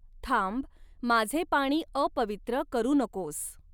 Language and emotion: Marathi, neutral